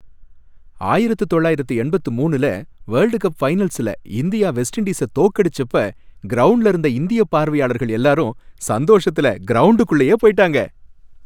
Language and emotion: Tamil, happy